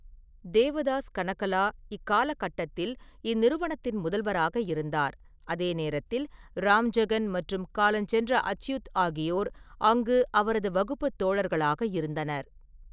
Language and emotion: Tamil, neutral